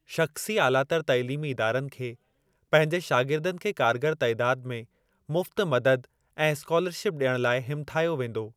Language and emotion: Sindhi, neutral